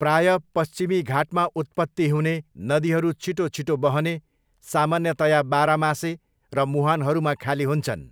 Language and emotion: Nepali, neutral